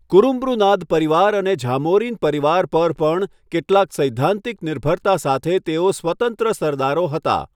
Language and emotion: Gujarati, neutral